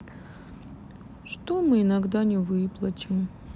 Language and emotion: Russian, sad